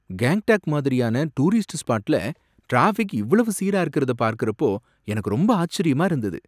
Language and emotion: Tamil, surprised